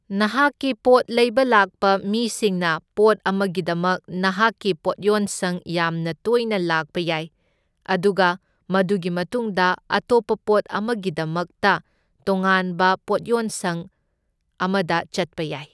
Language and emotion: Manipuri, neutral